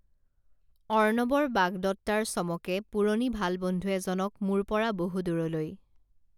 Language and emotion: Assamese, neutral